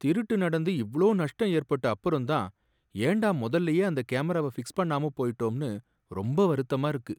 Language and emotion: Tamil, sad